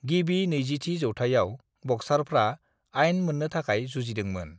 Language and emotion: Bodo, neutral